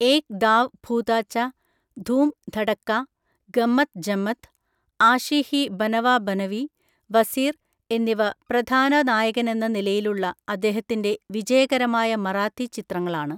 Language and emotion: Malayalam, neutral